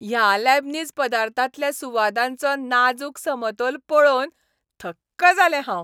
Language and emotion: Goan Konkani, happy